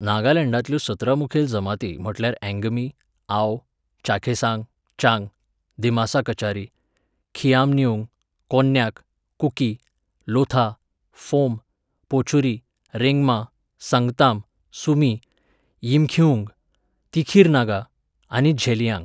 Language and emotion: Goan Konkani, neutral